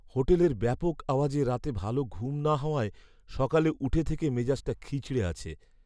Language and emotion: Bengali, sad